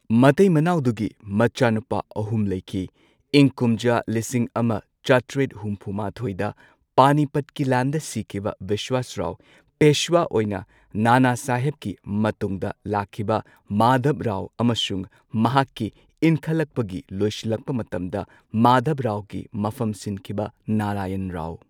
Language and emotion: Manipuri, neutral